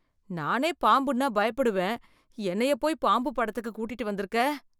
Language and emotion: Tamil, fearful